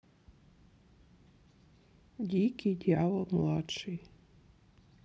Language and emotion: Russian, sad